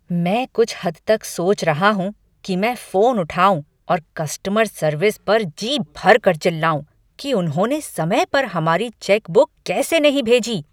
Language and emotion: Hindi, angry